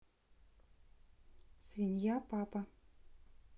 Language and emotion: Russian, neutral